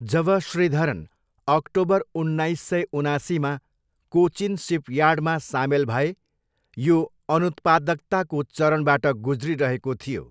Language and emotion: Nepali, neutral